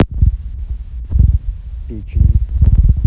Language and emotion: Russian, neutral